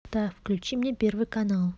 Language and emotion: Russian, neutral